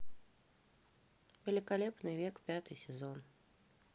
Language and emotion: Russian, neutral